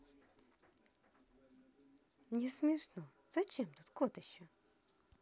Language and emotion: Russian, positive